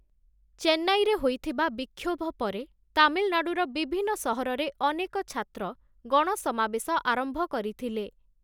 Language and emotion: Odia, neutral